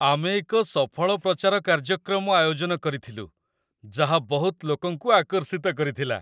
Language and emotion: Odia, happy